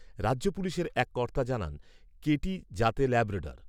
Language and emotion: Bengali, neutral